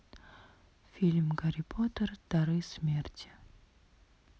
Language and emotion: Russian, sad